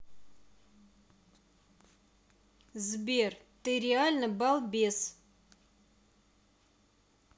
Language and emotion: Russian, angry